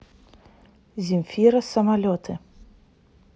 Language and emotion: Russian, neutral